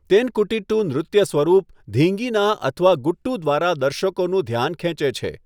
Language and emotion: Gujarati, neutral